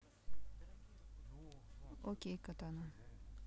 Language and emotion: Russian, neutral